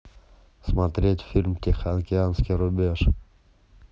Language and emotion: Russian, neutral